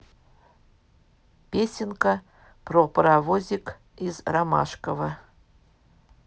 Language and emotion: Russian, neutral